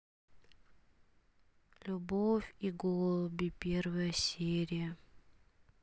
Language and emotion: Russian, sad